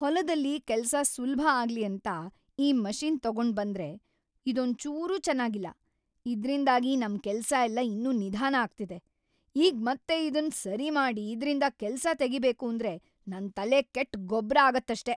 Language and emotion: Kannada, angry